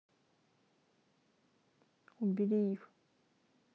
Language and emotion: Russian, neutral